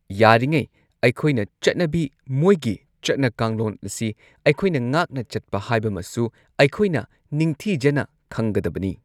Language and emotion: Manipuri, neutral